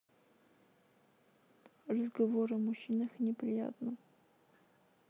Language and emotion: Russian, sad